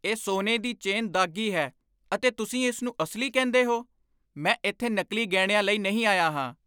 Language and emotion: Punjabi, angry